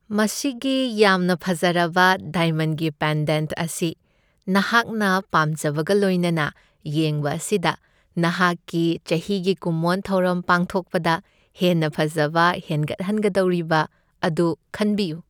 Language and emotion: Manipuri, happy